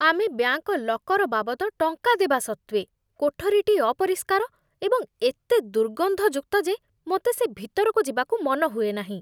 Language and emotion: Odia, disgusted